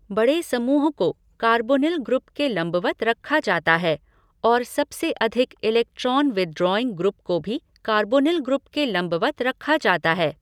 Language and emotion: Hindi, neutral